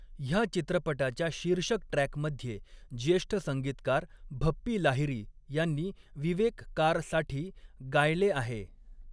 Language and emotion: Marathi, neutral